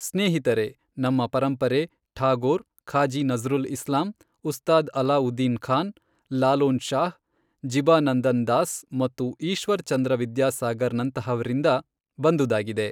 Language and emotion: Kannada, neutral